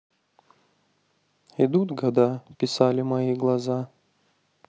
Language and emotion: Russian, sad